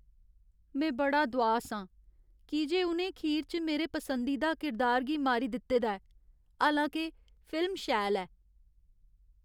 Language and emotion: Dogri, sad